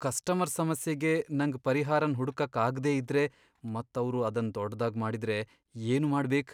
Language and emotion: Kannada, fearful